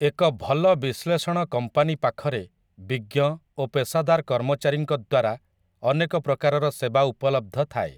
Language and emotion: Odia, neutral